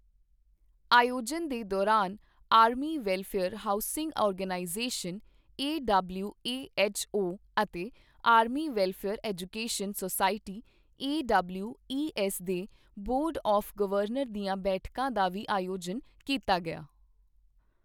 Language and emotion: Punjabi, neutral